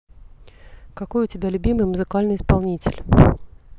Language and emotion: Russian, neutral